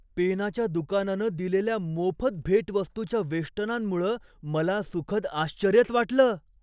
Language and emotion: Marathi, surprised